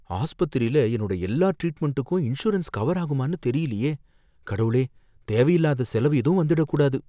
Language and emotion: Tamil, fearful